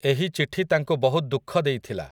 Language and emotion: Odia, neutral